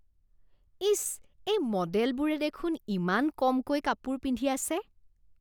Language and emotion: Assamese, disgusted